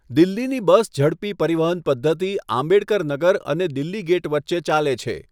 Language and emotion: Gujarati, neutral